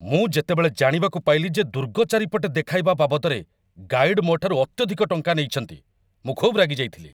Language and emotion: Odia, angry